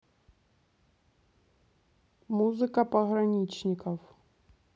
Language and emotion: Russian, neutral